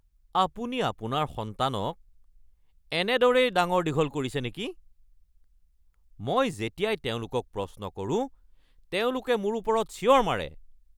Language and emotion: Assamese, angry